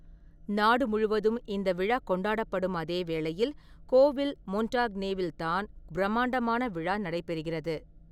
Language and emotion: Tamil, neutral